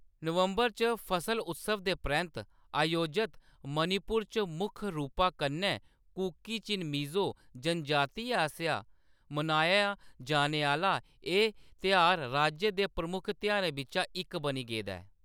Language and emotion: Dogri, neutral